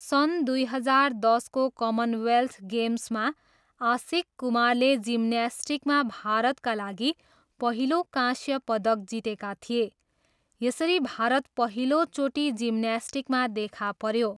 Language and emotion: Nepali, neutral